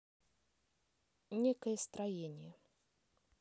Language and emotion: Russian, neutral